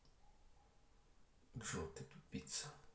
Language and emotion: Russian, angry